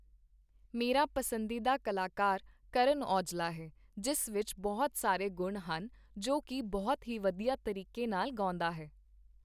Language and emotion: Punjabi, neutral